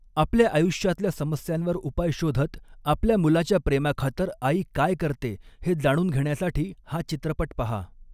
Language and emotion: Marathi, neutral